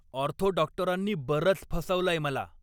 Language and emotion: Marathi, angry